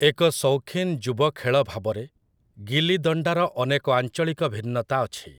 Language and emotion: Odia, neutral